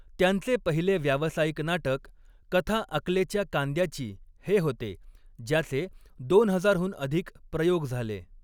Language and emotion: Marathi, neutral